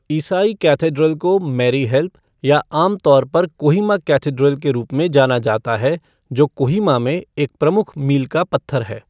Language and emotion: Hindi, neutral